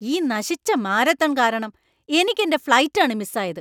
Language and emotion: Malayalam, angry